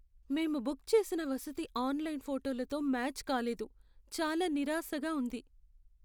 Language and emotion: Telugu, sad